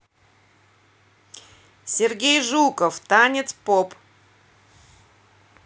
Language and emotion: Russian, neutral